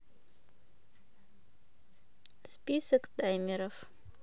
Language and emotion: Russian, neutral